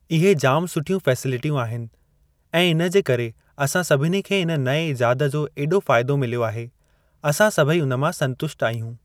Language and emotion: Sindhi, neutral